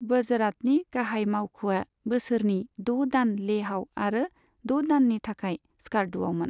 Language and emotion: Bodo, neutral